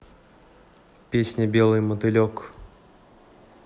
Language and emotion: Russian, neutral